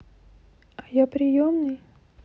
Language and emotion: Russian, sad